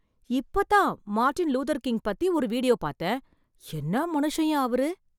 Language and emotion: Tamil, surprised